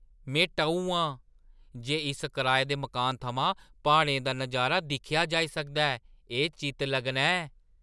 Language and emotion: Dogri, surprised